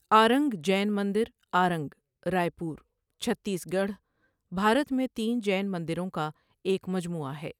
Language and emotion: Urdu, neutral